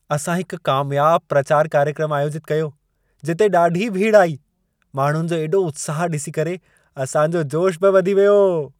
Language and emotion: Sindhi, happy